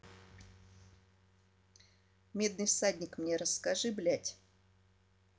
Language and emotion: Russian, angry